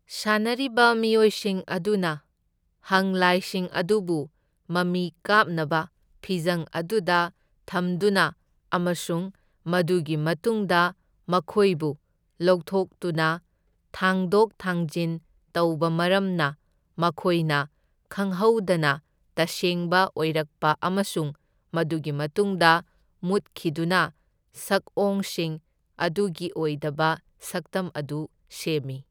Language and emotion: Manipuri, neutral